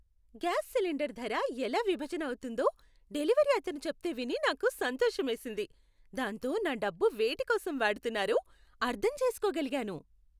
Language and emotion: Telugu, happy